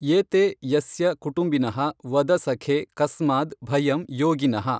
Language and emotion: Kannada, neutral